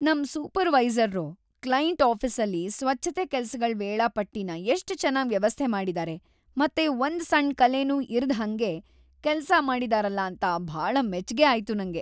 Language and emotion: Kannada, happy